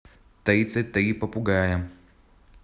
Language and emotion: Russian, neutral